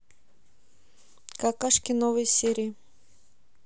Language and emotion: Russian, neutral